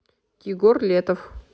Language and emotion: Russian, neutral